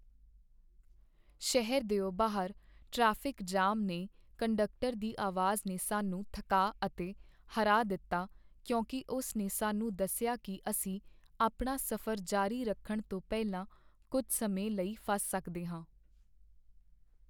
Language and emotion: Punjabi, sad